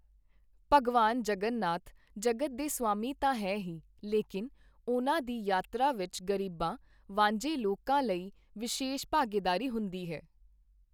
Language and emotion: Punjabi, neutral